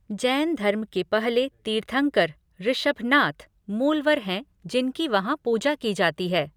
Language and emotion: Hindi, neutral